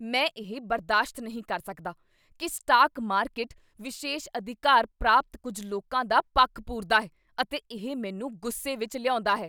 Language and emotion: Punjabi, angry